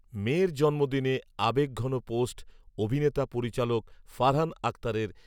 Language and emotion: Bengali, neutral